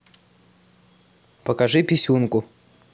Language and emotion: Russian, neutral